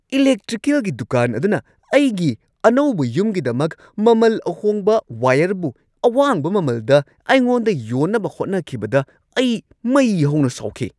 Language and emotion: Manipuri, angry